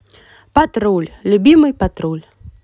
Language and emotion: Russian, positive